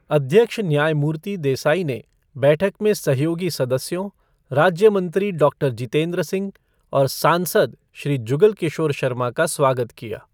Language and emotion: Hindi, neutral